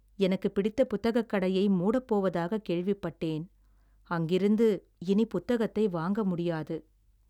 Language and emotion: Tamil, sad